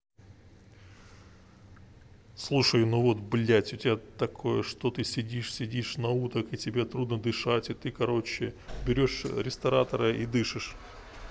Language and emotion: Russian, neutral